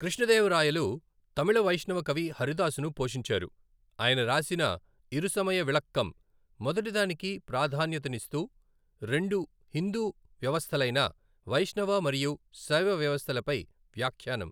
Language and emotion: Telugu, neutral